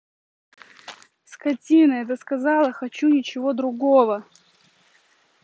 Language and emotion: Russian, angry